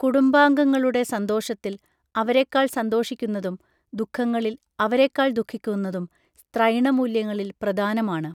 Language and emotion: Malayalam, neutral